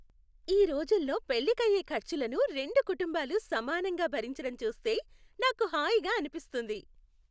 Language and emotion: Telugu, happy